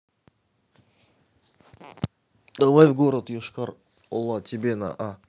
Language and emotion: Russian, neutral